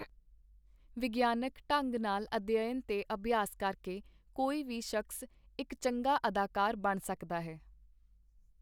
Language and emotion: Punjabi, neutral